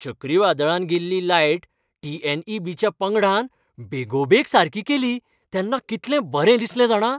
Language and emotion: Goan Konkani, happy